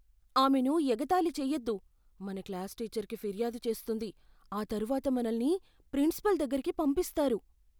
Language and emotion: Telugu, fearful